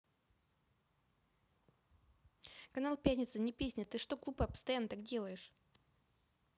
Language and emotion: Russian, angry